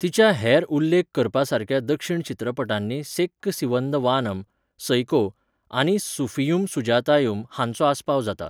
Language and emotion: Goan Konkani, neutral